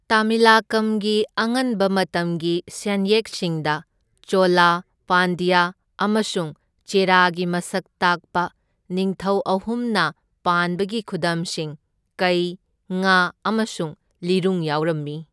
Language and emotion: Manipuri, neutral